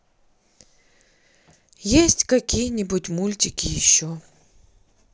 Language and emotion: Russian, sad